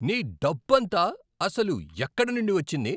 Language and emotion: Telugu, angry